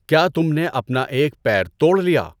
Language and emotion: Urdu, neutral